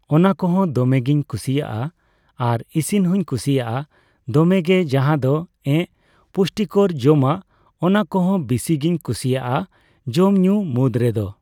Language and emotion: Santali, neutral